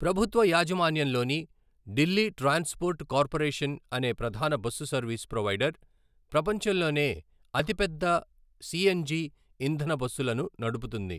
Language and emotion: Telugu, neutral